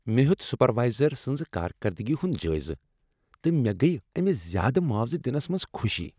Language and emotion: Kashmiri, happy